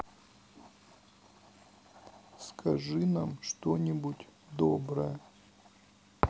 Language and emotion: Russian, sad